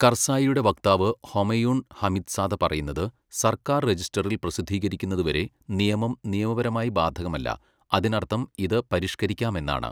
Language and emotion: Malayalam, neutral